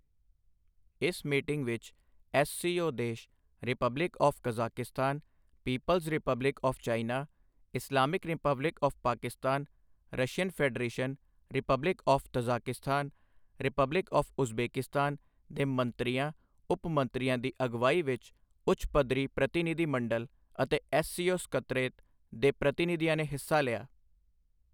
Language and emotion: Punjabi, neutral